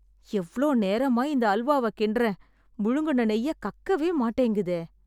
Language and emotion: Tamil, sad